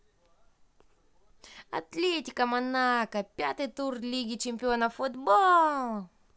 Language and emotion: Russian, positive